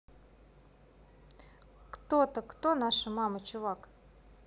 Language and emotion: Russian, neutral